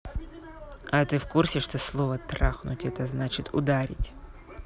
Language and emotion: Russian, neutral